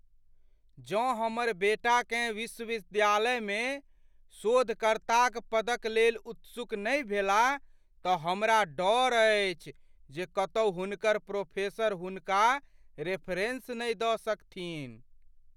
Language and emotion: Maithili, fearful